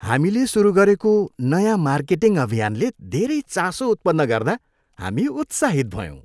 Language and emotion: Nepali, happy